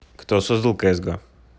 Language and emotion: Russian, neutral